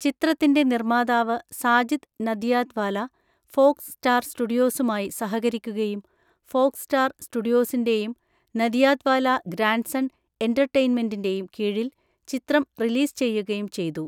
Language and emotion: Malayalam, neutral